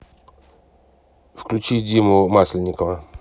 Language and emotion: Russian, neutral